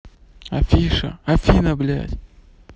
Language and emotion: Russian, angry